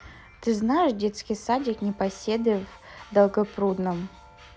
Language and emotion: Russian, neutral